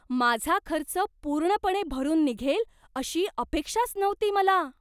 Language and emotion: Marathi, surprised